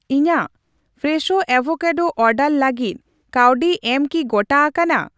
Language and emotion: Santali, neutral